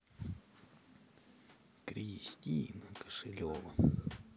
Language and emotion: Russian, neutral